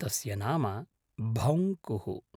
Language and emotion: Sanskrit, neutral